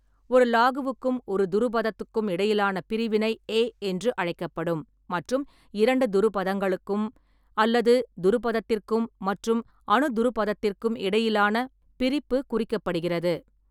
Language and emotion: Tamil, neutral